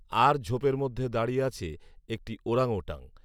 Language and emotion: Bengali, neutral